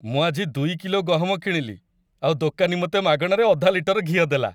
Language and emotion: Odia, happy